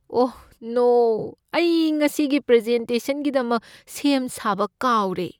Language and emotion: Manipuri, fearful